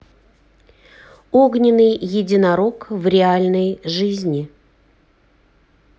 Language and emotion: Russian, neutral